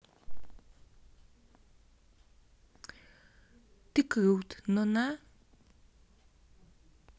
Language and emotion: Russian, neutral